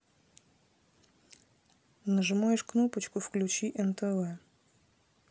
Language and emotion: Russian, neutral